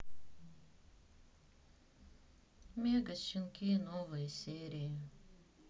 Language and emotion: Russian, sad